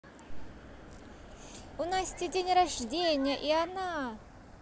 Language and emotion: Russian, positive